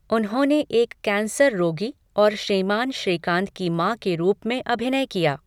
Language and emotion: Hindi, neutral